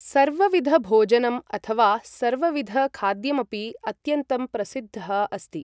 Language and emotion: Sanskrit, neutral